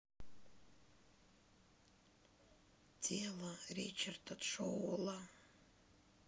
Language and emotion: Russian, sad